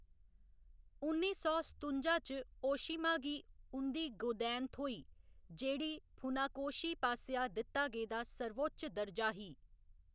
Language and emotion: Dogri, neutral